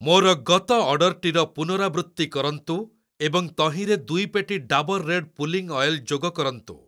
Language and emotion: Odia, neutral